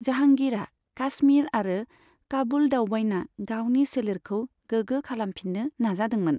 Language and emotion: Bodo, neutral